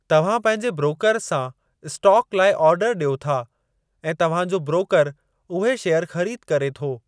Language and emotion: Sindhi, neutral